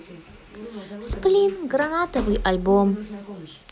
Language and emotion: Russian, positive